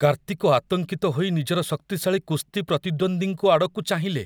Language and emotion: Odia, fearful